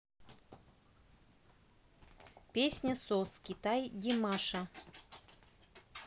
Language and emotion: Russian, neutral